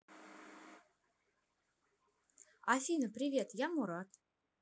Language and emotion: Russian, positive